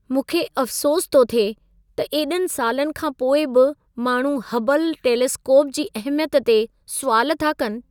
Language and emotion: Sindhi, sad